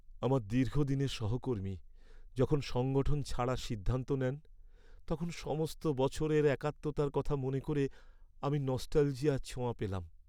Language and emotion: Bengali, sad